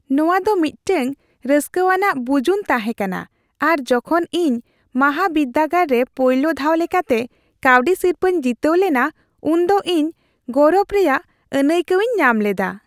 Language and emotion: Santali, happy